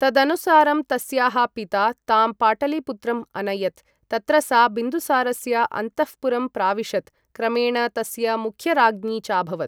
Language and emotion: Sanskrit, neutral